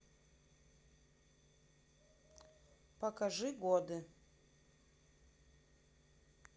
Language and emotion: Russian, neutral